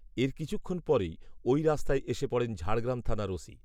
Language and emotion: Bengali, neutral